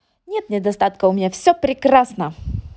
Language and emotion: Russian, positive